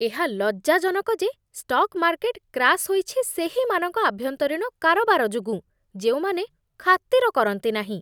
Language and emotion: Odia, disgusted